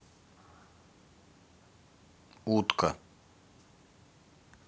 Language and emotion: Russian, neutral